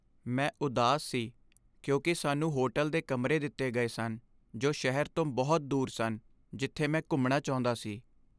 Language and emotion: Punjabi, sad